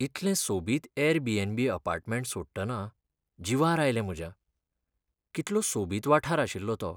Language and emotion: Goan Konkani, sad